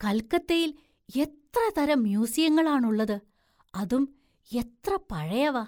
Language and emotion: Malayalam, surprised